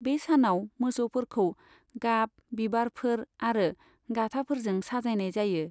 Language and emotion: Bodo, neutral